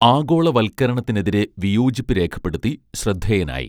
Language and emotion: Malayalam, neutral